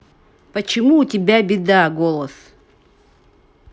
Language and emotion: Russian, neutral